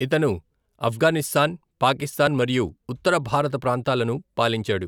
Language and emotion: Telugu, neutral